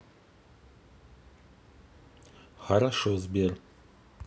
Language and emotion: Russian, neutral